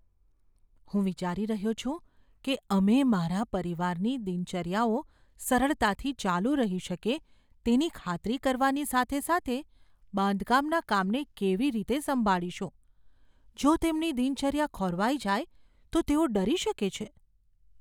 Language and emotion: Gujarati, fearful